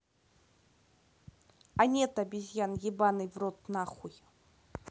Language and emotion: Russian, neutral